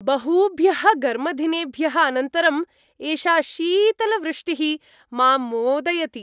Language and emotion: Sanskrit, happy